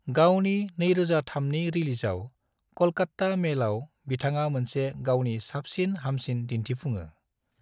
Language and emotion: Bodo, neutral